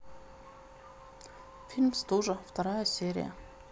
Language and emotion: Russian, neutral